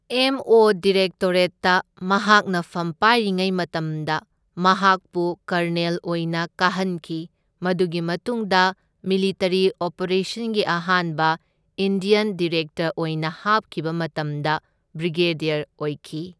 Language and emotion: Manipuri, neutral